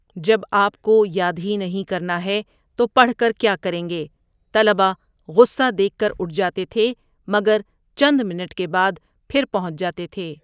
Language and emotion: Urdu, neutral